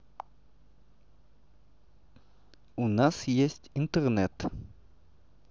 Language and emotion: Russian, neutral